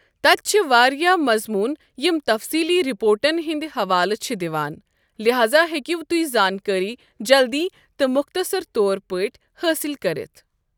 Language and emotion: Kashmiri, neutral